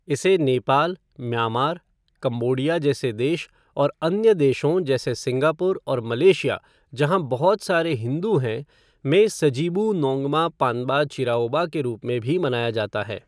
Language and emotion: Hindi, neutral